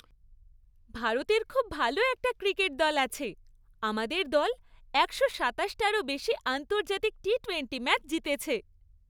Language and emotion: Bengali, happy